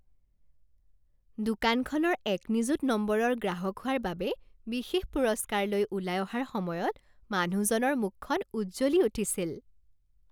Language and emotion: Assamese, happy